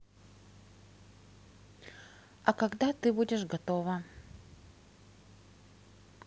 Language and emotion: Russian, neutral